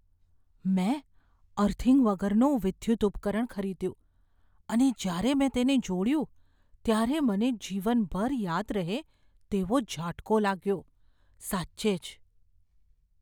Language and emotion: Gujarati, fearful